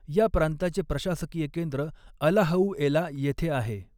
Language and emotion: Marathi, neutral